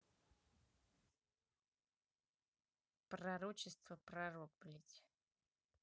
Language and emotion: Russian, neutral